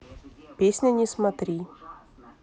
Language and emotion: Russian, neutral